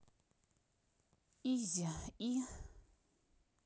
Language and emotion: Russian, neutral